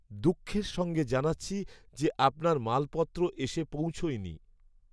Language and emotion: Bengali, sad